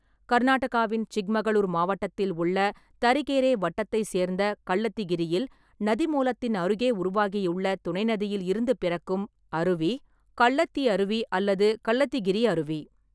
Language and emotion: Tamil, neutral